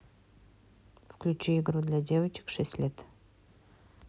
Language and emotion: Russian, neutral